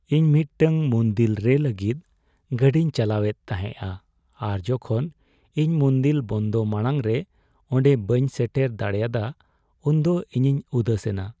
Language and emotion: Santali, sad